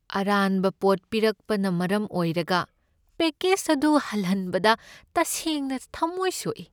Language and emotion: Manipuri, sad